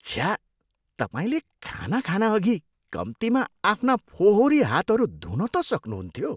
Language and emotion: Nepali, disgusted